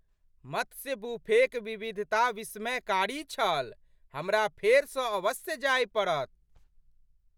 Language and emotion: Maithili, surprised